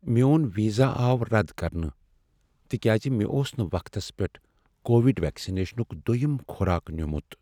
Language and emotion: Kashmiri, sad